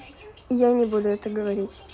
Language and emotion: Russian, neutral